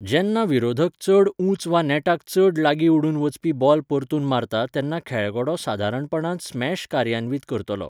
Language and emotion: Goan Konkani, neutral